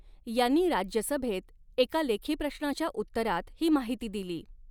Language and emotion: Marathi, neutral